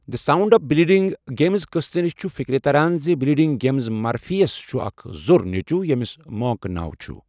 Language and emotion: Kashmiri, neutral